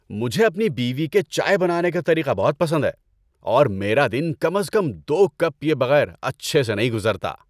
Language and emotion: Urdu, happy